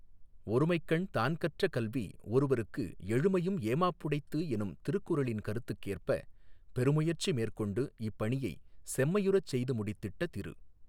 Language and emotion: Tamil, neutral